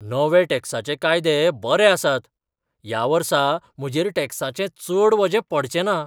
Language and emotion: Goan Konkani, surprised